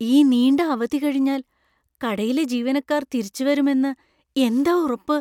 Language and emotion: Malayalam, fearful